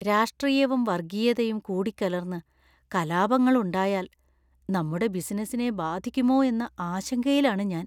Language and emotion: Malayalam, fearful